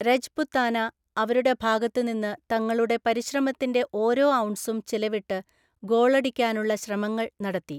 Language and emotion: Malayalam, neutral